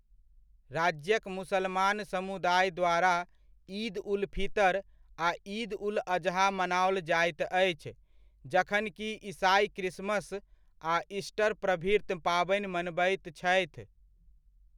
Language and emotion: Maithili, neutral